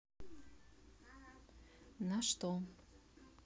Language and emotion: Russian, neutral